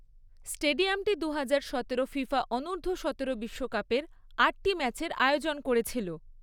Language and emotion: Bengali, neutral